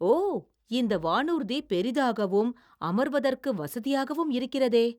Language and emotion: Tamil, surprised